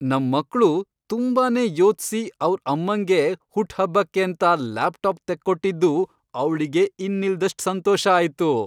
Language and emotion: Kannada, happy